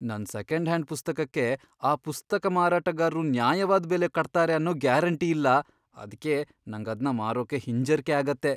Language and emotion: Kannada, fearful